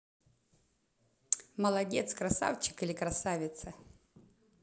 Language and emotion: Russian, positive